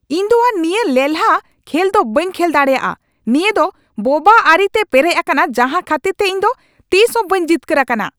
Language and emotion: Santali, angry